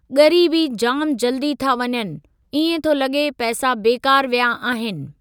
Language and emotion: Sindhi, neutral